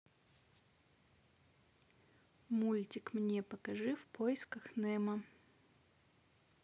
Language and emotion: Russian, neutral